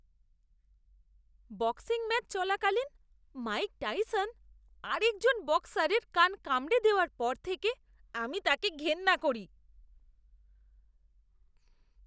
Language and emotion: Bengali, disgusted